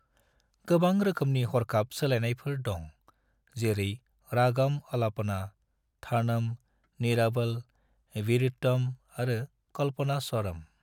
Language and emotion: Bodo, neutral